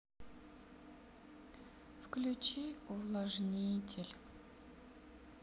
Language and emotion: Russian, sad